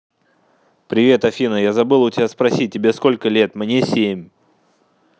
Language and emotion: Russian, neutral